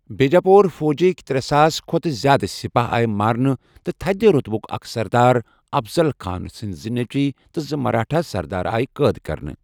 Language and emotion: Kashmiri, neutral